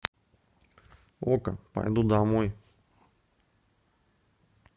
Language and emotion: Russian, neutral